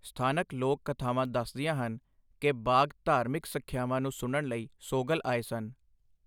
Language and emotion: Punjabi, neutral